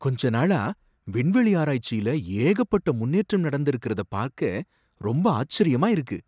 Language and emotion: Tamil, surprised